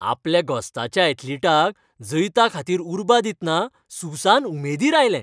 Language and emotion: Goan Konkani, happy